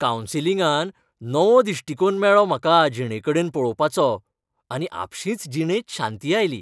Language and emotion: Goan Konkani, happy